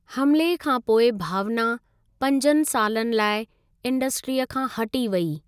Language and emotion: Sindhi, neutral